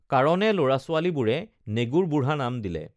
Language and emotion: Assamese, neutral